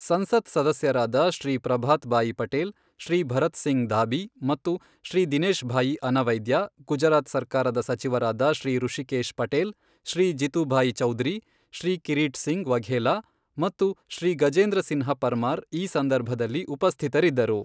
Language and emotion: Kannada, neutral